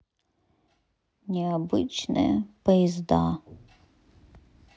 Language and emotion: Russian, sad